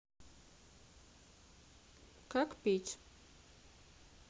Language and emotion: Russian, neutral